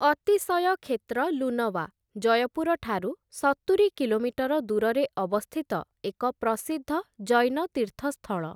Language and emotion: Odia, neutral